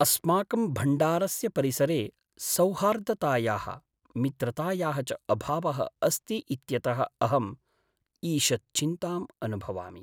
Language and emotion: Sanskrit, sad